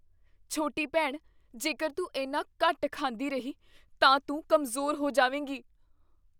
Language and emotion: Punjabi, fearful